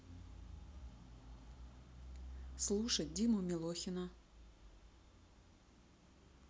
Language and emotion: Russian, neutral